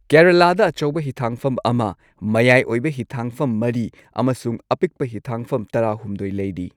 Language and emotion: Manipuri, neutral